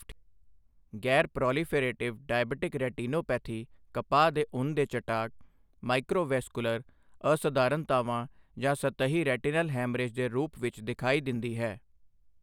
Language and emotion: Punjabi, neutral